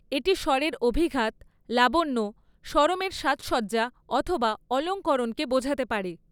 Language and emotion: Bengali, neutral